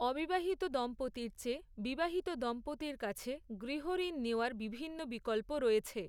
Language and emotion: Bengali, neutral